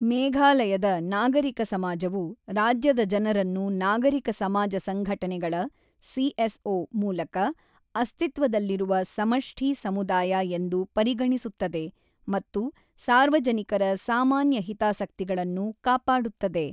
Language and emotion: Kannada, neutral